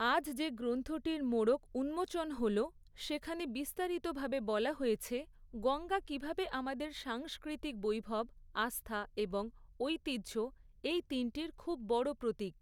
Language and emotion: Bengali, neutral